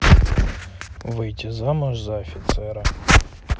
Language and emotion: Russian, neutral